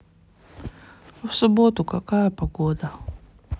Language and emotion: Russian, sad